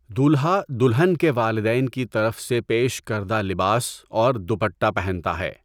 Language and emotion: Urdu, neutral